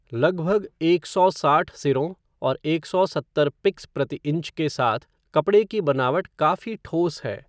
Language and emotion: Hindi, neutral